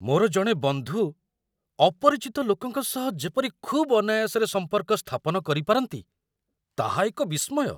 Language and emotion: Odia, surprised